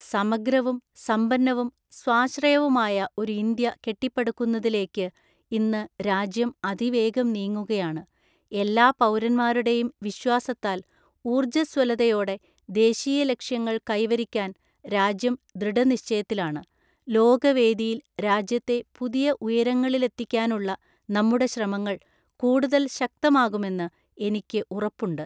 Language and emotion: Malayalam, neutral